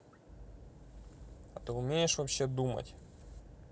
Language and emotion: Russian, neutral